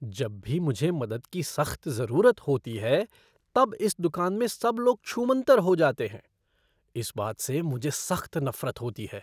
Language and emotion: Hindi, disgusted